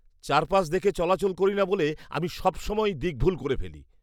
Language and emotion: Bengali, disgusted